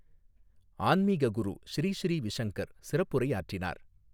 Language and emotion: Tamil, neutral